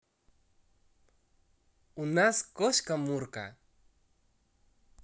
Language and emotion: Russian, positive